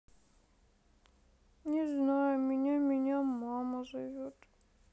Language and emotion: Russian, sad